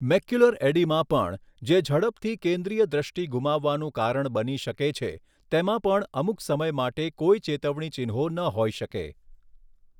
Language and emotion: Gujarati, neutral